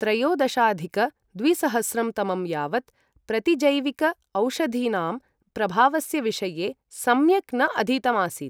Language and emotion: Sanskrit, neutral